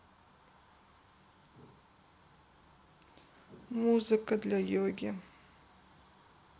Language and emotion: Russian, sad